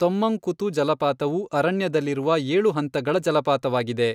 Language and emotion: Kannada, neutral